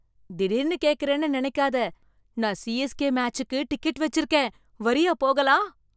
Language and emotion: Tamil, surprised